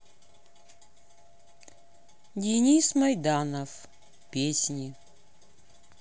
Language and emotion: Russian, neutral